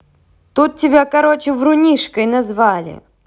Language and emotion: Russian, positive